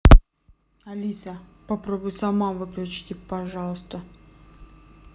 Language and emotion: Russian, neutral